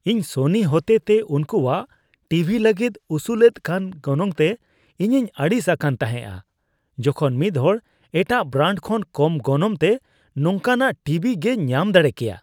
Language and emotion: Santali, disgusted